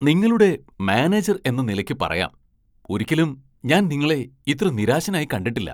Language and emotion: Malayalam, surprised